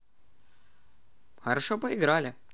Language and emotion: Russian, positive